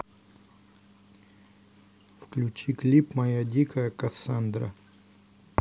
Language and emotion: Russian, neutral